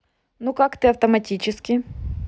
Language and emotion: Russian, neutral